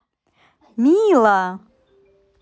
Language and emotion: Russian, positive